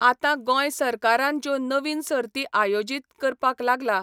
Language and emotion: Goan Konkani, neutral